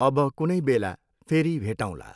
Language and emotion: Nepali, neutral